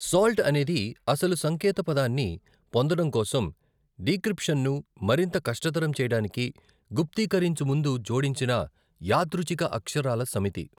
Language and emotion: Telugu, neutral